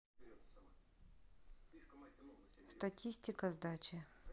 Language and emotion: Russian, neutral